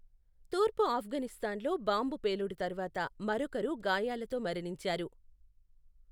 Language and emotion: Telugu, neutral